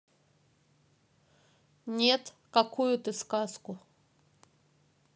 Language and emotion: Russian, neutral